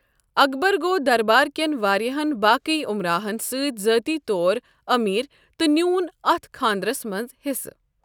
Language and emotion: Kashmiri, neutral